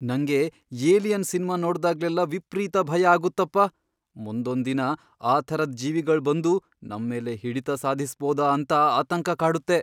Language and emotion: Kannada, fearful